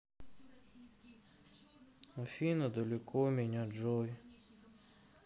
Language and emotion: Russian, sad